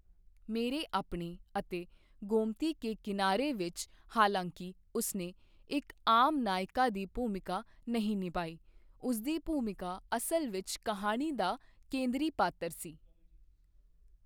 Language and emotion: Punjabi, neutral